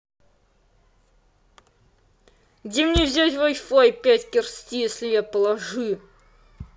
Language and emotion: Russian, angry